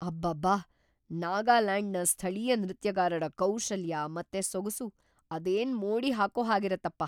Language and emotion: Kannada, surprised